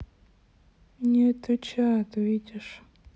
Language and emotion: Russian, sad